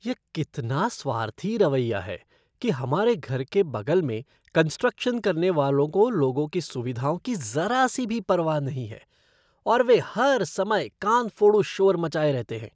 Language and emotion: Hindi, disgusted